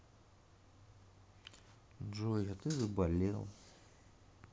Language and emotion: Russian, sad